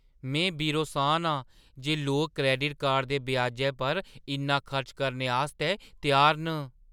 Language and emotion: Dogri, surprised